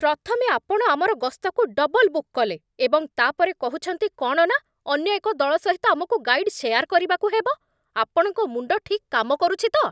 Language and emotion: Odia, angry